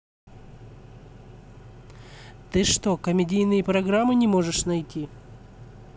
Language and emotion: Russian, angry